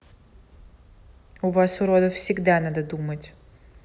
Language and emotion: Russian, angry